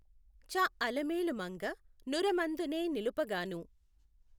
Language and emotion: Telugu, neutral